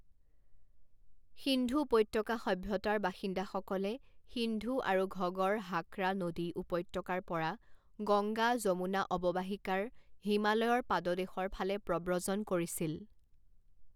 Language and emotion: Assamese, neutral